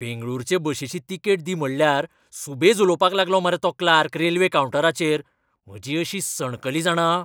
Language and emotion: Goan Konkani, angry